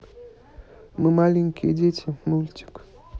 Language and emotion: Russian, neutral